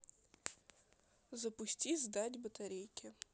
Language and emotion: Russian, neutral